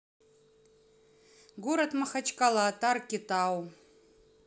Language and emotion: Russian, neutral